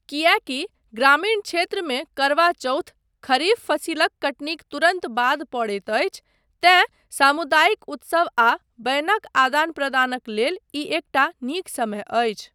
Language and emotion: Maithili, neutral